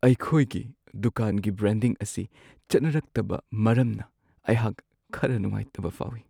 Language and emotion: Manipuri, sad